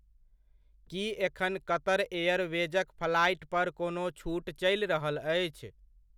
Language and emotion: Maithili, neutral